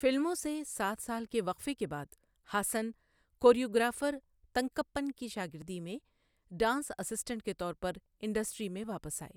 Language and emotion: Urdu, neutral